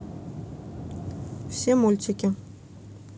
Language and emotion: Russian, neutral